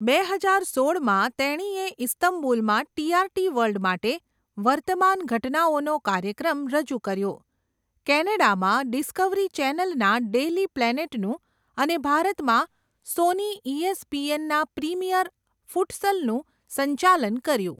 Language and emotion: Gujarati, neutral